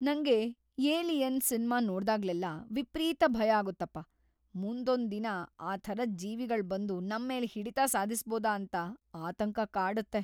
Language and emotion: Kannada, fearful